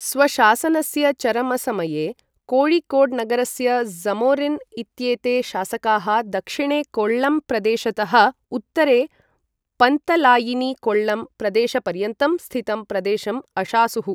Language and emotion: Sanskrit, neutral